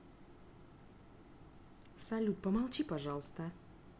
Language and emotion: Russian, angry